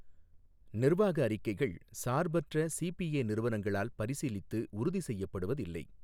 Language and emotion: Tamil, neutral